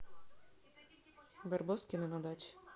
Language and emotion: Russian, neutral